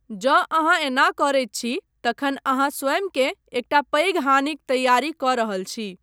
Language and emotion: Maithili, neutral